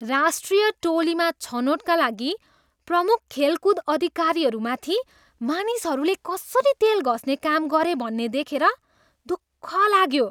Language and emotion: Nepali, disgusted